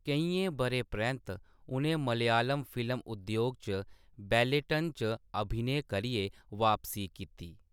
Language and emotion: Dogri, neutral